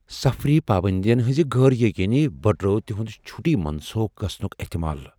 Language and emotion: Kashmiri, fearful